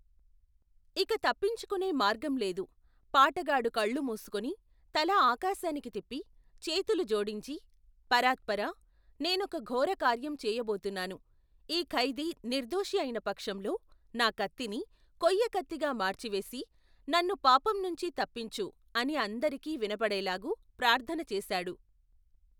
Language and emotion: Telugu, neutral